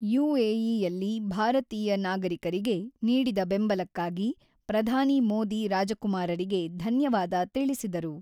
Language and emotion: Kannada, neutral